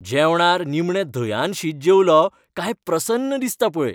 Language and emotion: Goan Konkani, happy